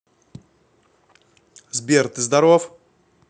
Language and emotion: Russian, neutral